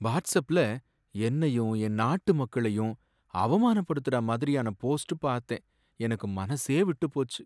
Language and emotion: Tamil, sad